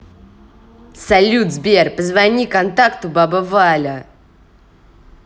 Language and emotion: Russian, angry